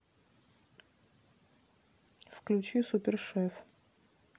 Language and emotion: Russian, neutral